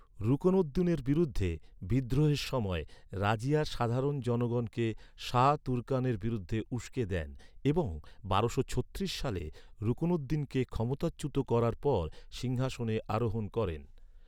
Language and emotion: Bengali, neutral